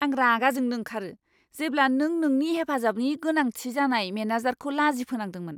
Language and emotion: Bodo, angry